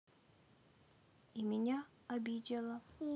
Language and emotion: Russian, sad